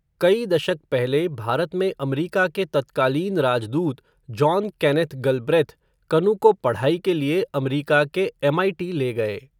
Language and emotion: Hindi, neutral